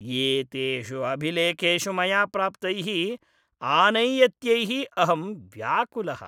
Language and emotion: Sanskrit, disgusted